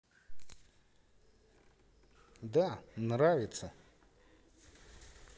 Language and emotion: Russian, positive